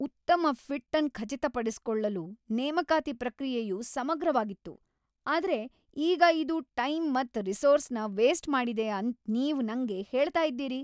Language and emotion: Kannada, angry